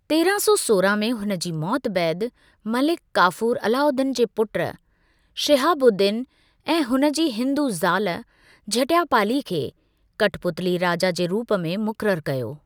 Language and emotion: Sindhi, neutral